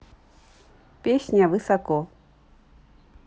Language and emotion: Russian, neutral